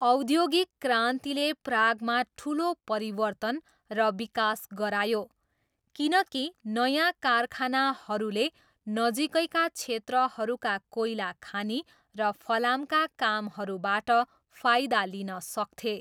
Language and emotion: Nepali, neutral